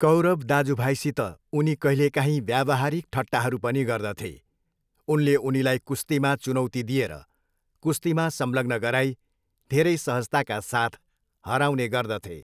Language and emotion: Nepali, neutral